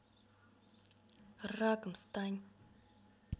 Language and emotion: Russian, angry